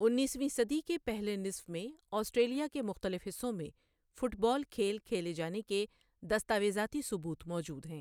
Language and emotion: Urdu, neutral